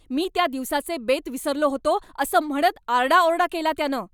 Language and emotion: Marathi, angry